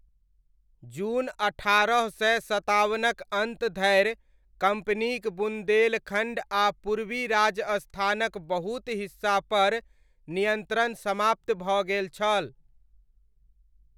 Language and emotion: Maithili, neutral